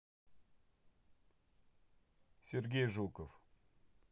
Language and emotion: Russian, neutral